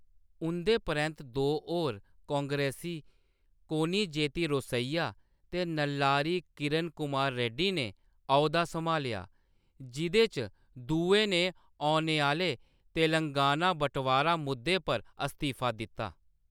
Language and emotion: Dogri, neutral